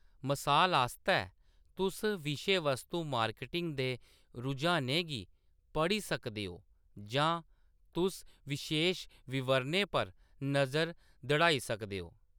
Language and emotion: Dogri, neutral